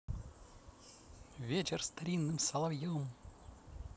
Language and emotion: Russian, positive